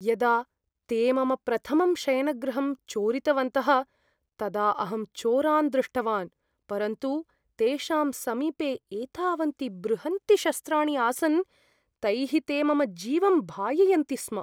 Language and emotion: Sanskrit, fearful